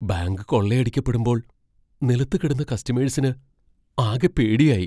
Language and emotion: Malayalam, fearful